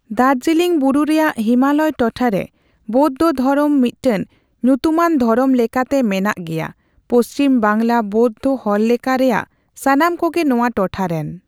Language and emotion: Santali, neutral